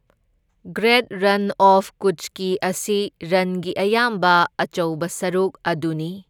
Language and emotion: Manipuri, neutral